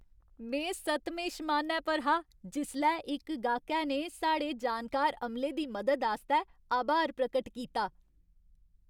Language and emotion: Dogri, happy